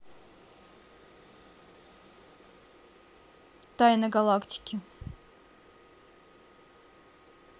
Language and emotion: Russian, neutral